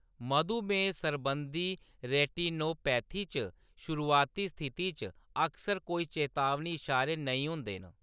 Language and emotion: Dogri, neutral